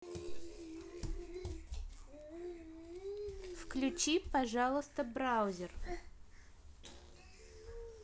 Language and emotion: Russian, neutral